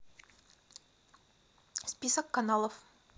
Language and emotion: Russian, neutral